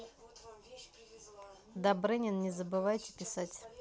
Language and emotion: Russian, neutral